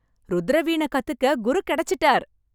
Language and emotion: Tamil, happy